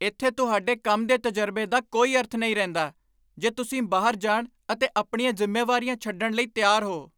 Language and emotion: Punjabi, angry